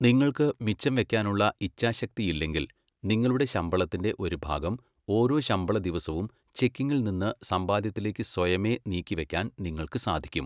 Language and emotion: Malayalam, neutral